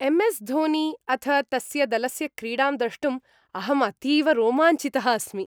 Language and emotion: Sanskrit, happy